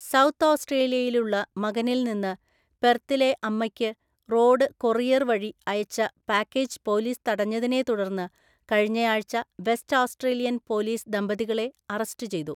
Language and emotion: Malayalam, neutral